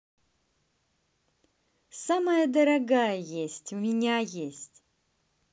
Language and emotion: Russian, positive